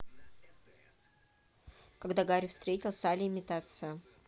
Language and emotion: Russian, neutral